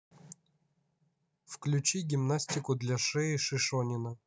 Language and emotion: Russian, neutral